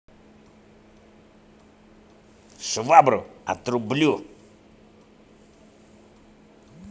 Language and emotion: Russian, angry